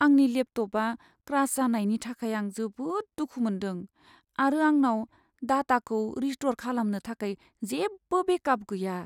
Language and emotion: Bodo, sad